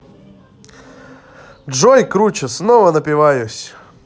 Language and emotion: Russian, positive